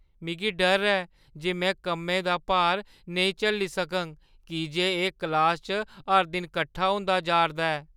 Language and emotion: Dogri, fearful